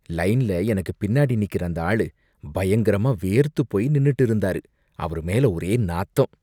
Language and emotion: Tamil, disgusted